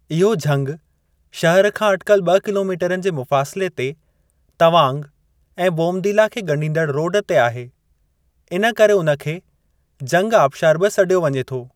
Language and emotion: Sindhi, neutral